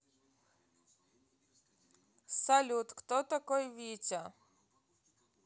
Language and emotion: Russian, neutral